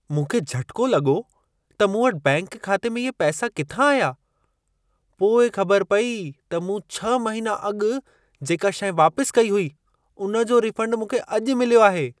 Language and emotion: Sindhi, surprised